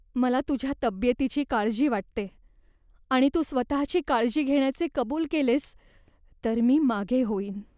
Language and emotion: Marathi, fearful